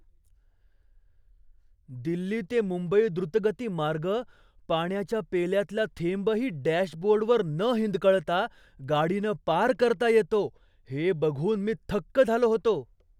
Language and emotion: Marathi, surprised